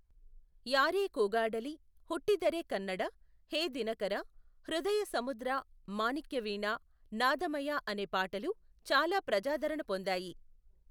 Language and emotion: Telugu, neutral